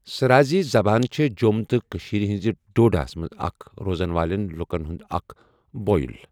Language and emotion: Kashmiri, neutral